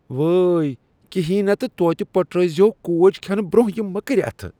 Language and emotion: Kashmiri, disgusted